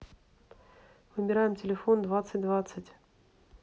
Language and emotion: Russian, neutral